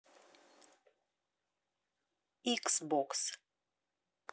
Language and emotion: Russian, neutral